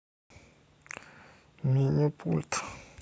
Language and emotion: Russian, sad